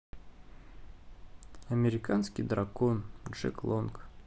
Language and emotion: Russian, neutral